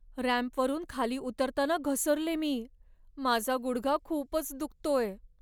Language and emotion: Marathi, sad